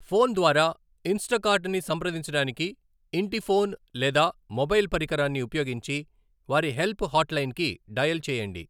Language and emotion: Telugu, neutral